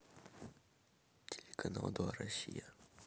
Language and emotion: Russian, sad